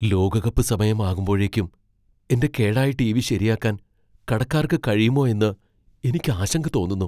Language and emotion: Malayalam, fearful